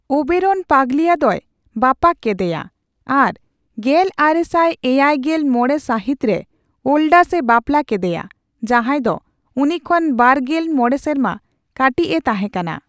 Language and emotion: Santali, neutral